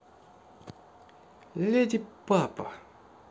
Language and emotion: Russian, neutral